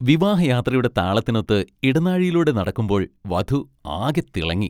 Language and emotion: Malayalam, happy